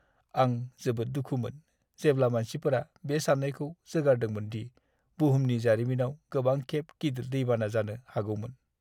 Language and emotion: Bodo, sad